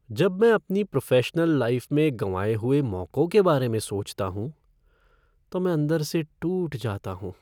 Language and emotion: Hindi, sad